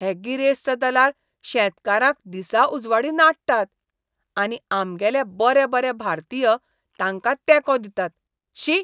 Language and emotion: Goan Konkani, disgusted